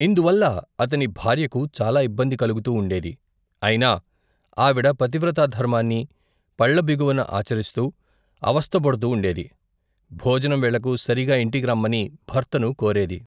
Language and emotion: Telugu, neutral